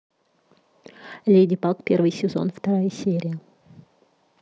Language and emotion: Russian, neutral